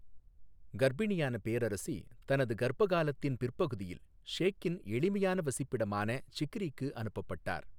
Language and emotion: Tamil, neutral